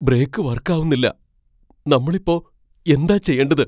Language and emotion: Malayalam, fearful